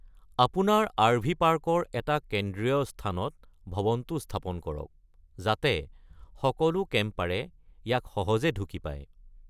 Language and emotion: Assamese, neutral